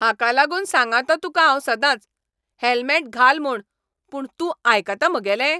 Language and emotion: Goan Konkani, angry